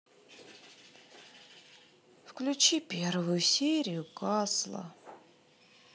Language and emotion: Russian, sad